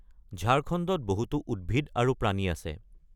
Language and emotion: Assamese, neutral